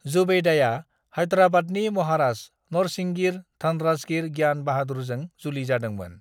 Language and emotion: Bodo, neutral